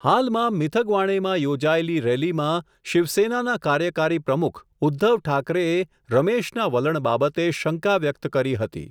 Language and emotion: Gujarati, neutral